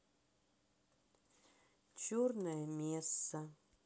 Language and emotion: Russian, sad